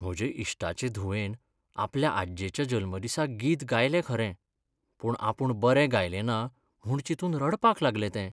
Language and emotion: Goan Konkani, sad